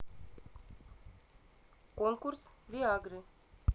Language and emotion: Russian, neutral